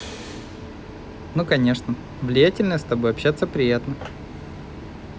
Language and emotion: Russian, positive